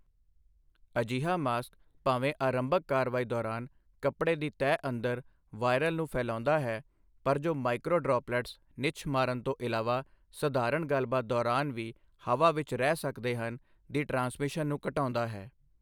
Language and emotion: Punjabi, neutral